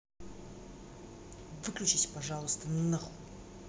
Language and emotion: Russian, angry